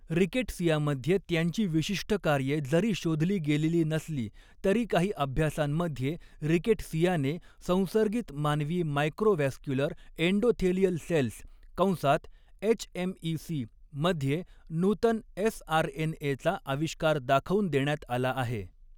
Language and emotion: Marathi, neutral